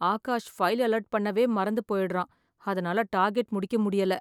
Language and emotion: Tamil, sad